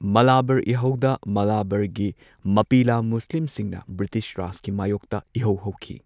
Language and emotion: Manipuri, neutral